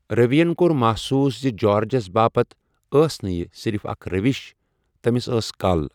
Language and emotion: Kashmiri, neutral